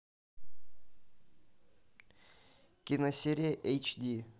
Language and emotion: Russian, neutral